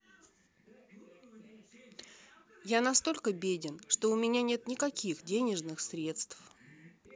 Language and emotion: Russian, neutral